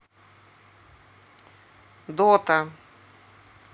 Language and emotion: Russian, neutral